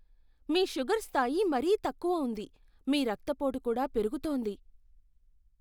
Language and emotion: Telugu, fearful